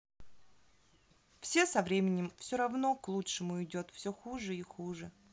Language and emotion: Russian, neutral